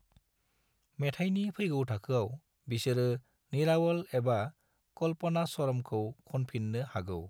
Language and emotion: Bodo, neutral